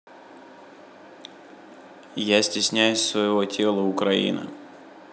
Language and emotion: Russian, neutral